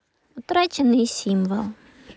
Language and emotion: Russian, neutral